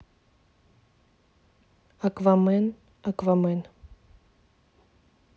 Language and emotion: Russian, neutral